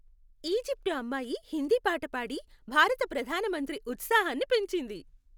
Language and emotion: Telugu, happy